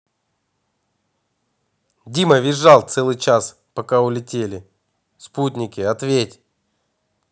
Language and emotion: Russian, neutral